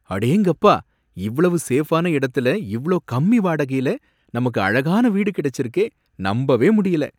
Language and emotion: Tamil, surprised